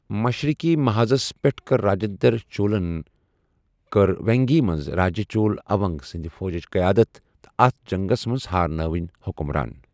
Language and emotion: Kashmiri, neutral